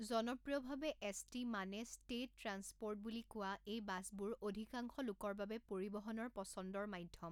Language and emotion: Assamese, neutral